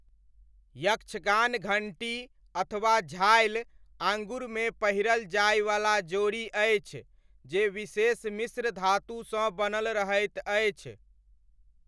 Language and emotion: Maithili, neutral